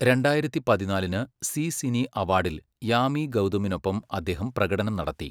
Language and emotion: Malayalam, neutral